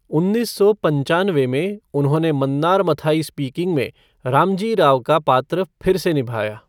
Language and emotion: Hindi, neutral